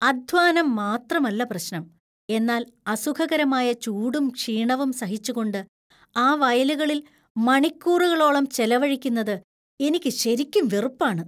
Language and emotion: Malayalam, disgusted